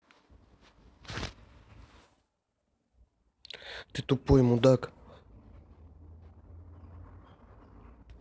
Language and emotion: Russian, angry